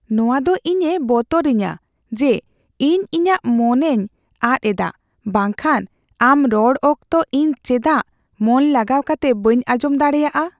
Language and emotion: Santali, fearful